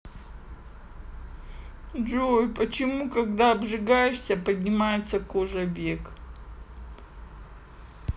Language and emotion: Russian, sad